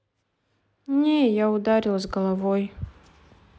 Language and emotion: Russian, sad